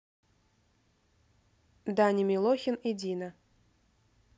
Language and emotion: Russian, neutral